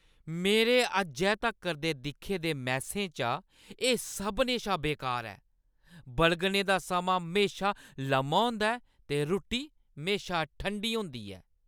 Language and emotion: Dogri, angry